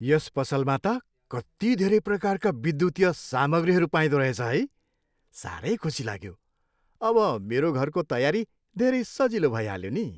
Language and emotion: Nepali, happy